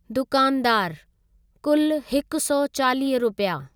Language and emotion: Sindhi, neutral